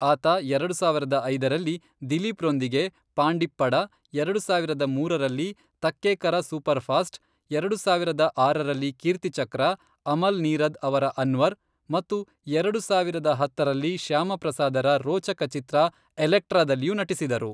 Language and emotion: Kannada, neutral